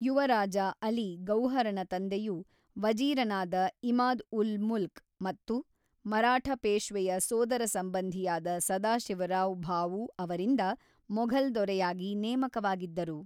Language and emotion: Kannada, neutral